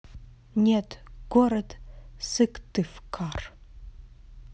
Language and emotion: Russian, neutral